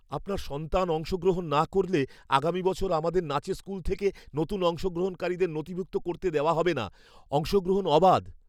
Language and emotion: Bengali, fearful